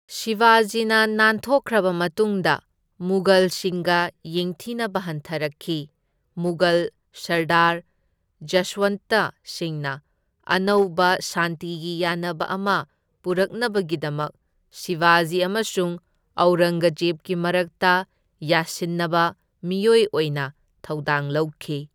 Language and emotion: Manipuri, neutral